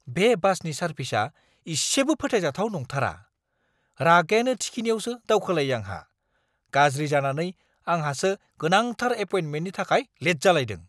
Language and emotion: Bodo, angry